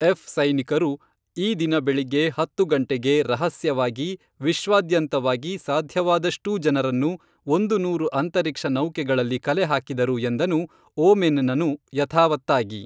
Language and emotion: Kannada, neutral